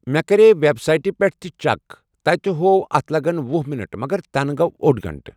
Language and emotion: Kashmiri, neutral